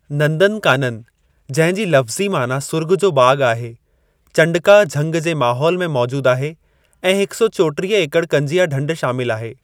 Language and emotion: Sindhi, neutral